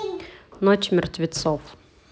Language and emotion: Russian, neutral